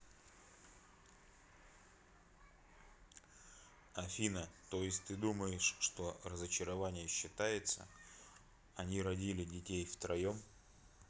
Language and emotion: Russian, neutral